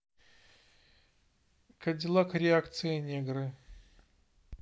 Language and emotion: Russian, neutral